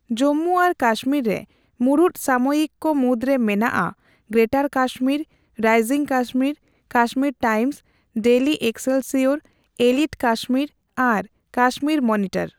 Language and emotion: Santali, neutral